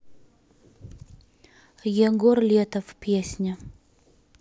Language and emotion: Russian, neutral